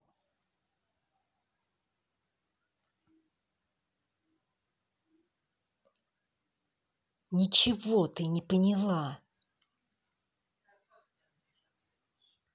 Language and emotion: Russian, angry